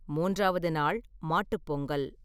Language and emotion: Tamil, neutral